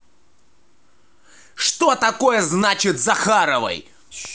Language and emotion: Russian, angry